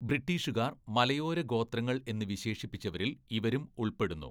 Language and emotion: Malayalam, neutral